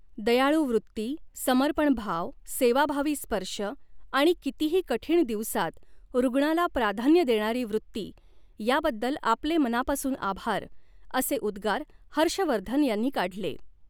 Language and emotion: Marathi, neutral